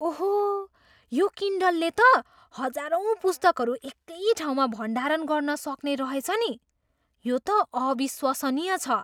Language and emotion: Nepali, surprised